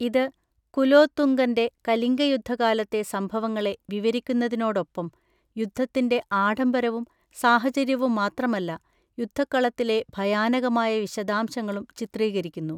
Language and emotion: Malayalam, neutral